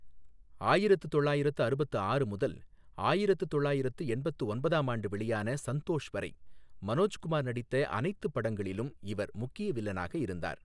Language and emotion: Tamil, neutral